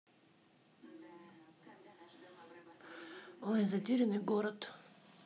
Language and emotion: Russian, neutral